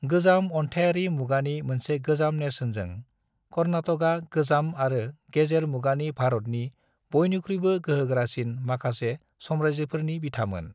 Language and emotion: Bodo, neutral